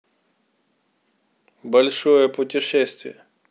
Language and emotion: Russian, neutral